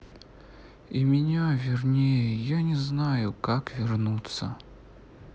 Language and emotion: Russian, sad